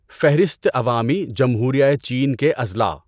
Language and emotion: Urdu, neutral